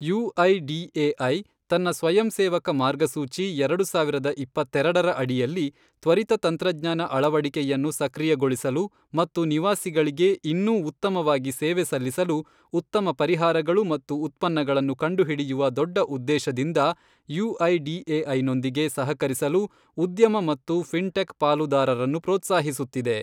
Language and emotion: Kannada, neutral